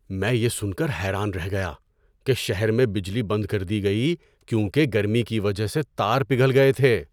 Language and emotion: Urdu, surprised